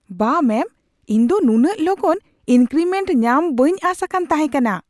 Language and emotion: Santali, surprised